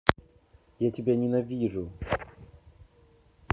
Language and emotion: Russian, angry